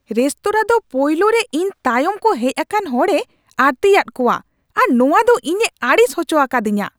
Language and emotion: Santali, angry